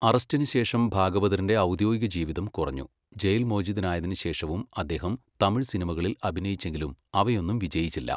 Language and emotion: Malayalam, neutral